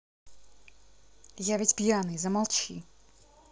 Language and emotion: Russian, angry